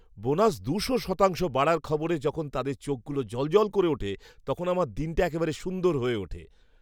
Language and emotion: Bengali, happy